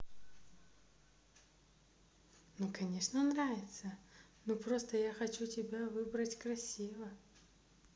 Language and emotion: Russian, positive